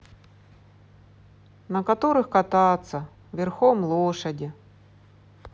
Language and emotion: Russian, sad